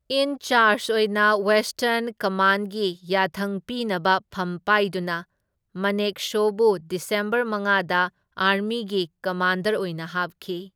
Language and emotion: Manipuri, neutral